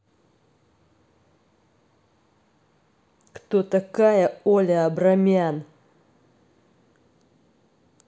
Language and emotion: Russian, angry